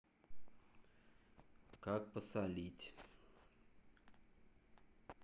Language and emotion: Russian, neutral